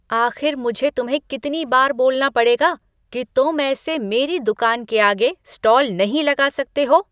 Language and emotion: Hindi, angry